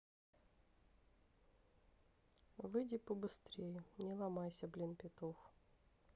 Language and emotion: Russian, neutral